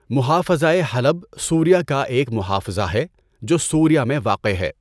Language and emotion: Urdu, neutral